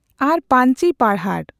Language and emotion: Santali, neutral